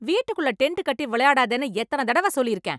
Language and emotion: Tamil, angry